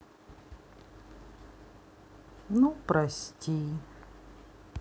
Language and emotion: Russian, sad